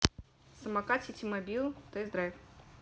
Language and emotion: Russian, neutral